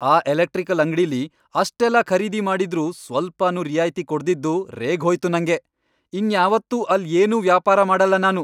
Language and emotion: Kannada, angry